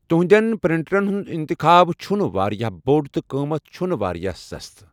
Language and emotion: Kashmiri, neutral